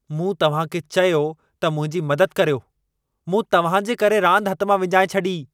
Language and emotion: Sindhi, angry